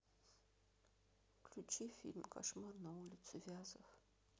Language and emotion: Russian, sad